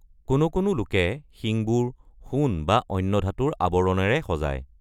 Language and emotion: Assamese, neutral